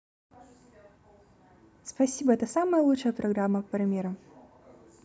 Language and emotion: Russian, positive